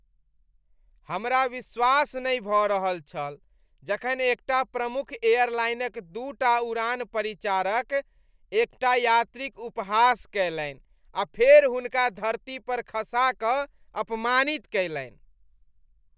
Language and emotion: Maithili, disgusted